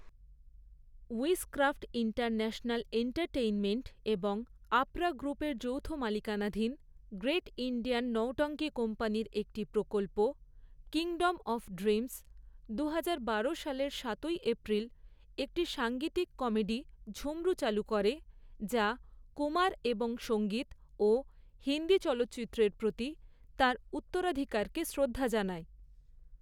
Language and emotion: Bengali, neutral